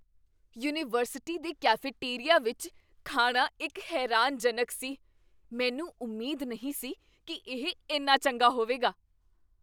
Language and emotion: Punjabi, surprised